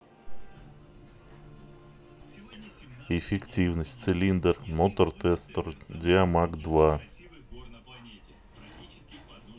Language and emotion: Russian, neutral